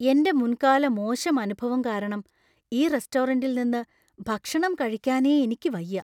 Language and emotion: Malayalam, fearful